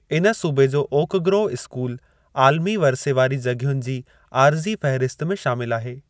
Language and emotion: Sindhi, neutral